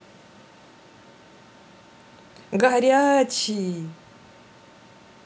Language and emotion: Russian, positive